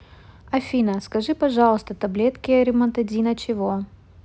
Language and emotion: Russian, neutral